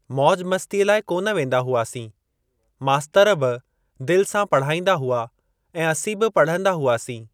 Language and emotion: Sindhi, neutral